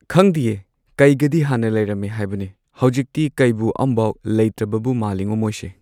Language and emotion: Manipuri, neutral